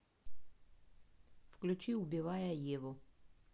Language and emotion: Russian, neutral